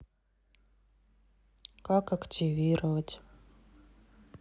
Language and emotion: Russian, sad